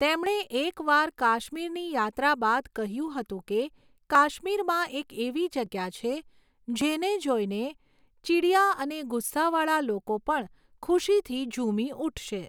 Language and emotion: Gujarati, neutral